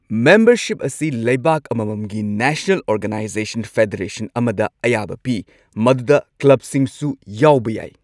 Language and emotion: Manipuri, neutral